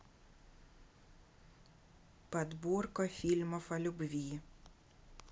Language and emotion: Russian, neutral